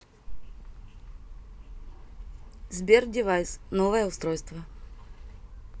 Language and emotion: Russian, neutral